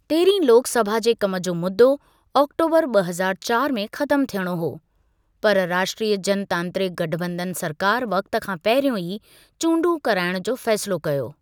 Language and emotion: Sindhi, neutral